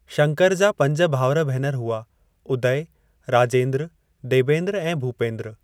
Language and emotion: Sindhi, neutral